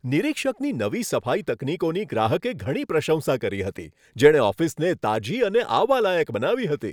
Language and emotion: Gujarati, happy